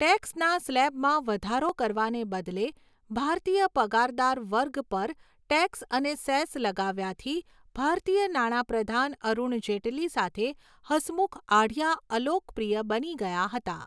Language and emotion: Gujarati, neutral